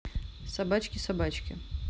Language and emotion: Russian, neutral